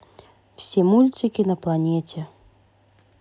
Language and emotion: Russian, neutral